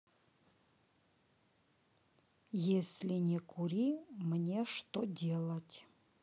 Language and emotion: Russian, neutral